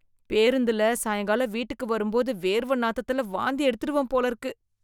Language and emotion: Tamil, disgusted